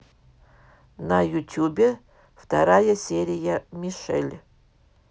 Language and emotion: Russian, neutral